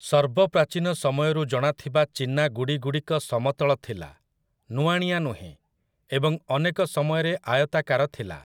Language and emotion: Odia, neutral